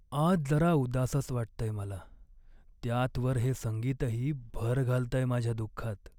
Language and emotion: Marathi, sad